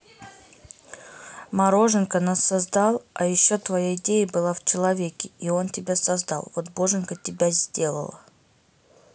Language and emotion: Russian, neutral